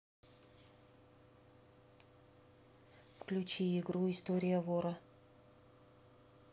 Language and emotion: Russian, neutral